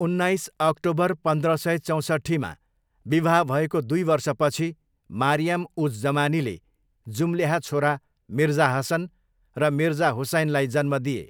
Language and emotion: Nepali, neutral